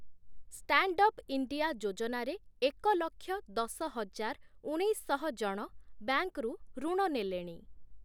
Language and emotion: Odia, neutral